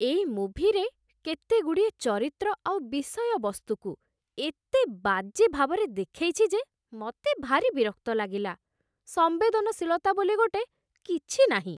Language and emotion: Odia, disgusted